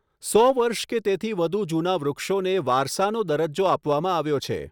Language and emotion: Gujarati, neutral